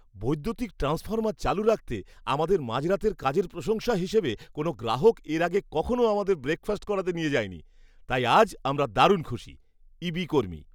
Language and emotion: Bengali, happy